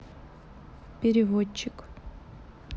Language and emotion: Russian, neutral